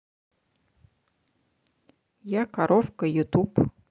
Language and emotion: Russian, neutral